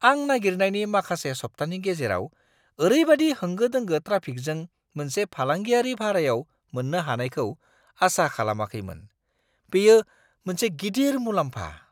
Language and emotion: Bodo, surprised